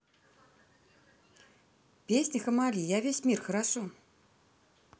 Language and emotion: Russian, neutral